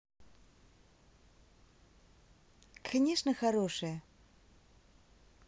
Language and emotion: Russian, positive